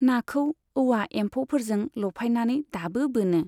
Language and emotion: Bodo, neutral